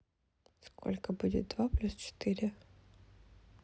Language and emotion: Russian, sad